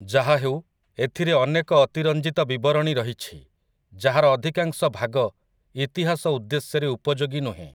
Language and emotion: Odia, neutral